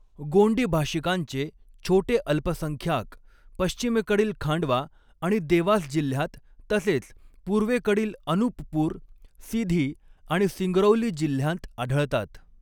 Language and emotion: Marathi, neutral